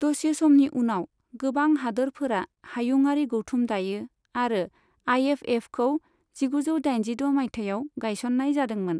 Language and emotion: Bodo, neutral